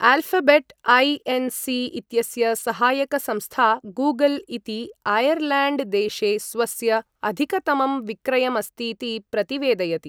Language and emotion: Sanskrit, neutral